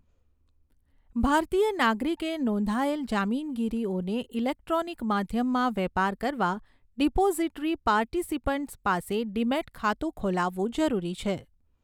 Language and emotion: Gujarati, neutral